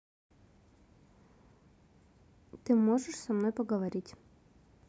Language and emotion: Russian, neutral